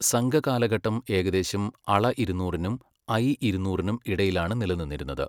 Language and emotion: Malayalam, neutral